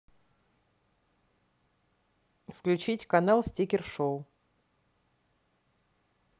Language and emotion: Russian, neutral